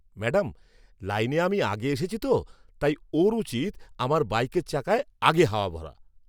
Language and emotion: Bengali, angry